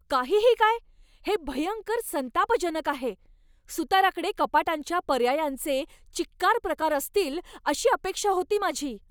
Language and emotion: Marathi, angry